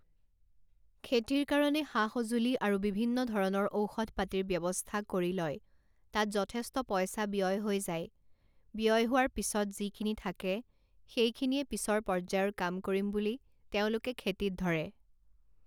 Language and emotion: Assamese, neutral